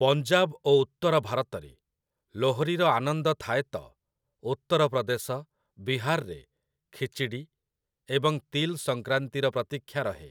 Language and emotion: Odia, neutral